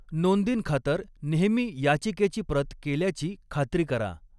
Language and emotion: Marathi, neutral